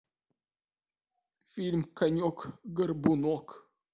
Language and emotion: Russian, sad